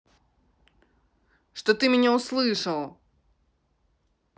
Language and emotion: Russian, angry